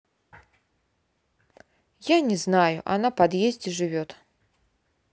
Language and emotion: Russian, neutral